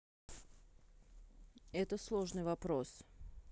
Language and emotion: Russian, neutral